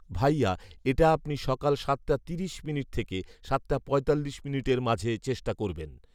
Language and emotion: Bengali, neutral